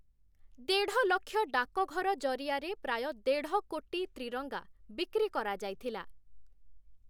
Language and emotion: Odia, neutral